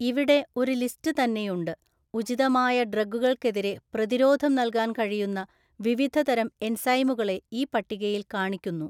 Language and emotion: Malayalam, neutral